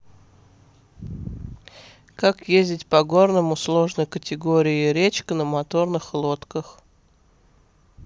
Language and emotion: Russian, neutral